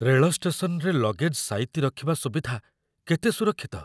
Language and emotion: Odia, fearful